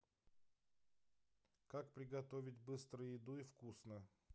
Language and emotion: Russian, neutral